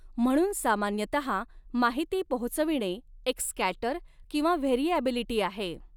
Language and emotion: Marathi, neutral